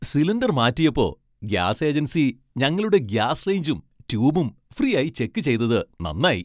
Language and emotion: Malayalam, happy